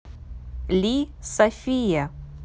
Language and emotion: Russian, neutral